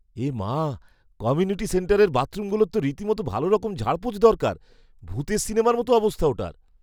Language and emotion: Bengali, disgusted